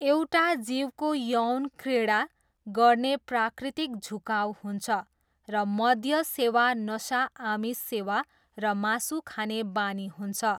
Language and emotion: Nepali, neutral